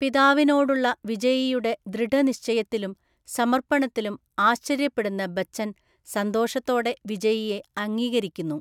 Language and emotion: Malayalam, neutral